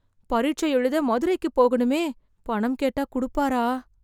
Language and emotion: Tamil, fearful